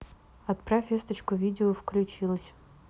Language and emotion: Russian, neutral